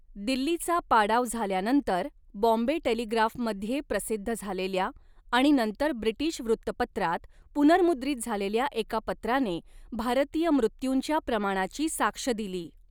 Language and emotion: Marathi, neutral